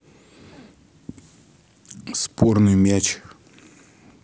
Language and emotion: Russian, neutral